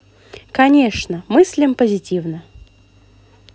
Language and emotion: Russian, positive